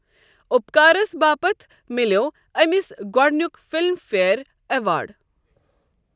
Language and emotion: Kashmiri, neutral